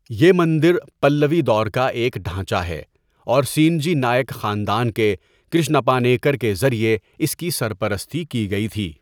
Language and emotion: Urdu, neutral